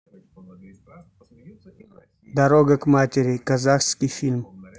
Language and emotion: Russian, neutral